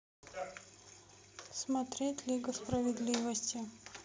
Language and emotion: Russian, neutral